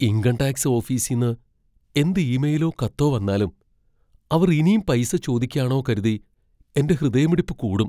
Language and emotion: Malayalam, fearful